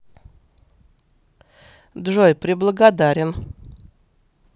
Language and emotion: Russian, neutral